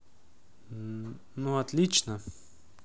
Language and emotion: Russian, neutral